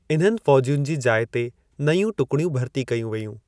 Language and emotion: Sindhi, neutral